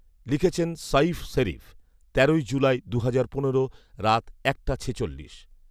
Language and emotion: Bengali, neutral